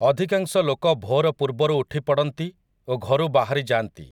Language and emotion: Odia, neutral